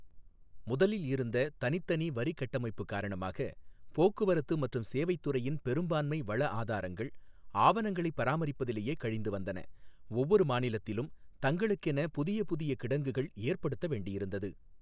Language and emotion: Tamil, neutral